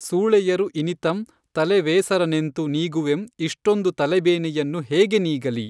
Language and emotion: Kannada, neutral